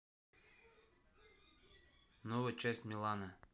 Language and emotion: Russian, neutral